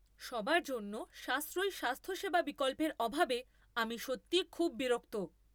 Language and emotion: Bengali, angry